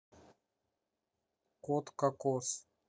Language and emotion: Russian, neutral